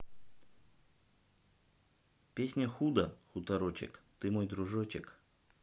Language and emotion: Russian, neutral